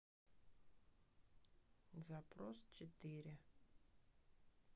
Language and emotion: Russian, sad